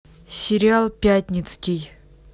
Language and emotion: Russian, neutral